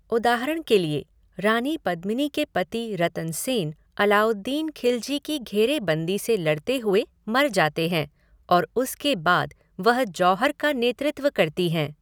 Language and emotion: Hindi, neutral